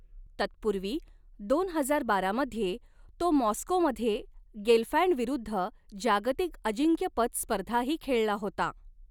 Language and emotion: Marathi, neutral